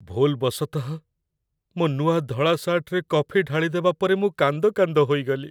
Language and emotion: Odia, sad